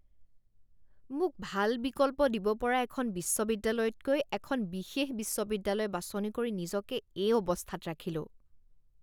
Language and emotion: Assamese, disgusted